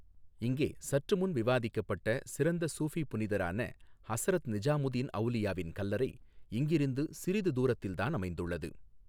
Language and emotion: Tamil, neutral